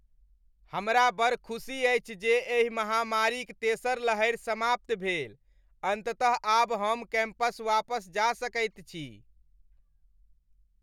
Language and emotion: Maithili, happy